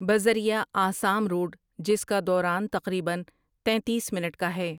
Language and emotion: Urdu, neutral